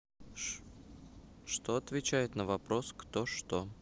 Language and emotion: Russian, neutral